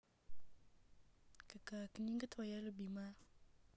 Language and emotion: Russian, neutral